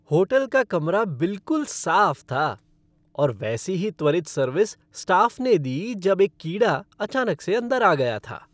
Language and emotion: Hindi, happy